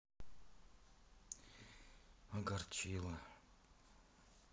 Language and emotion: Russian, sad